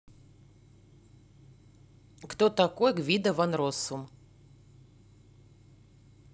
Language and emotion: Russian, neutral